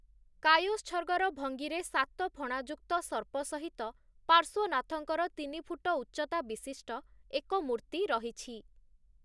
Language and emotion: Odia, neutral